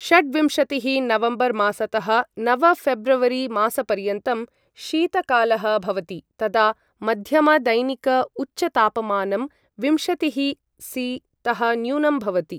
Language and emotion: Sanskrit, neutral